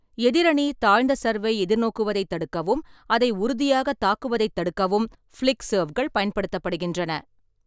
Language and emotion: Tamil, neutral